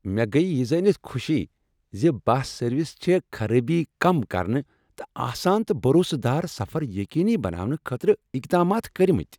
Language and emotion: Kashmiri, happy